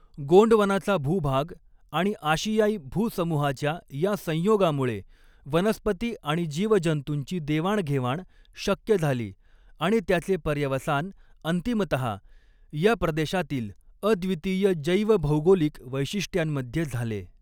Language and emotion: Marathi, neutral